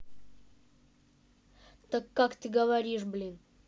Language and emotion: Russian, angry